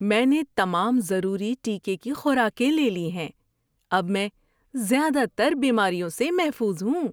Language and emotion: Urdu, happy